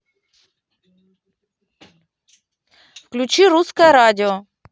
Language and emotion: Russian, neutral